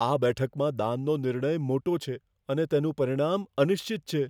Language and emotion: Gujarati, fearful